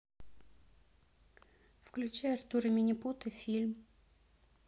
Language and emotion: Russian, neutral